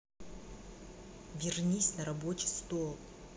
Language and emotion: Russian, angry